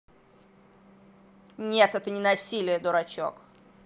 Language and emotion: Russian, angry